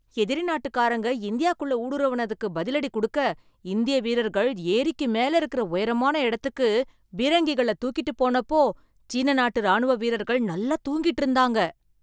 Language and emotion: Tamil, surprised